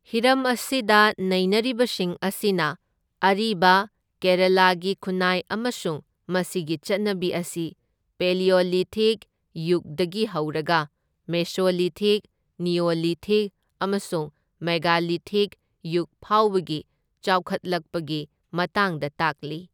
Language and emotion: Manipuri, neutral